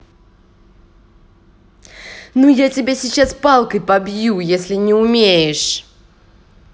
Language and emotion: Russian, angry